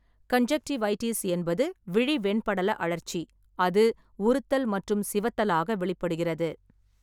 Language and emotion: Tamil, neutral